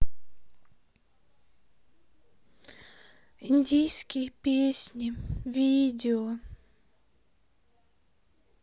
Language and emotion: Russian, sad